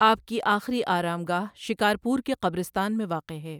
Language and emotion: Urdu, neutral